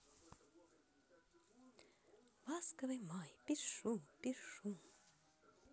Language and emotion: Russian, positive